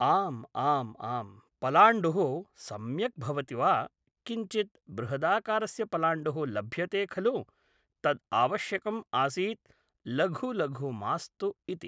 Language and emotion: Sanskrit, neutral